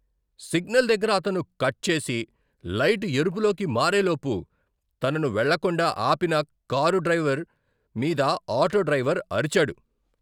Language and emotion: Telugu, angry